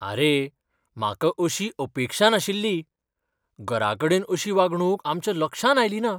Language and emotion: Goan Konkani, surprised